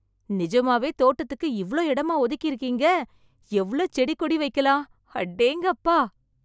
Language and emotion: Tamil, surprised